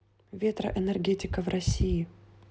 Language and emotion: Russian, neutral